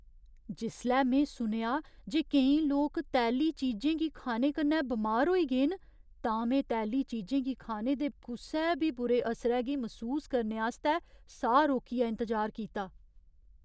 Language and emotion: Dogri, fearful